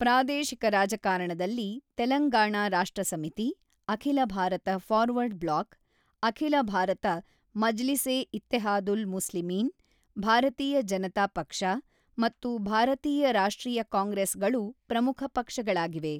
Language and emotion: Kannada, neutral